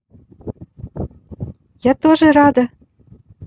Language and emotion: Russian, positive